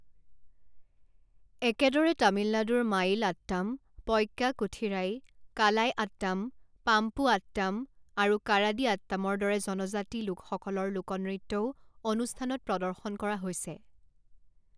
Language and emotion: Assamese, neutral